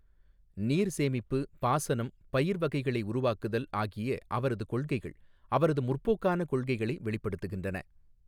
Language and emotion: Tamil, neutral